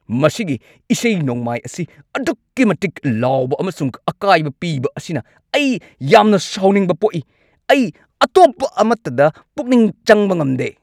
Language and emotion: Manipuri, angry